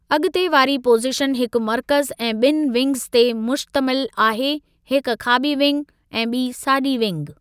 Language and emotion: Sindhi, neutral